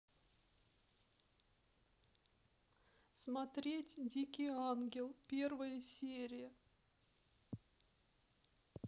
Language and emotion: Russian, sad